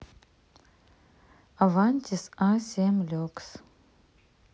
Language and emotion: Russian, neutral